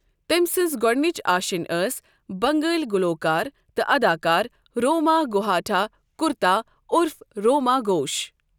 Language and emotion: Kashmiri, neutral